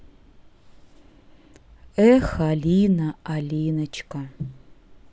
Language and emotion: Russian, sad